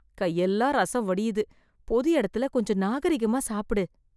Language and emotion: Tamil, disgusted